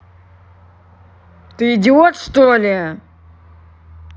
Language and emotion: Russian, angry